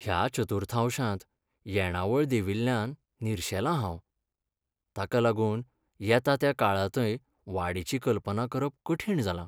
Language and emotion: Goan Konkani, sad